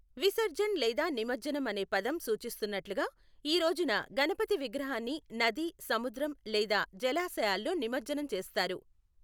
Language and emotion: Telugu, neutral